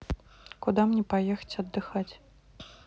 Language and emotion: Russian, neutral